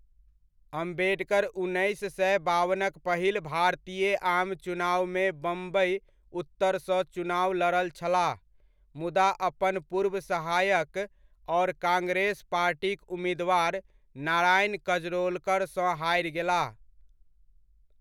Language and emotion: Maithili, neutral